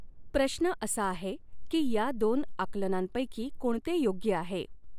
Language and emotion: Marathi, neutral